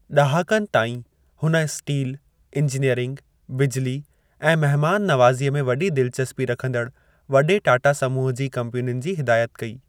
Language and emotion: Sindhi, neutral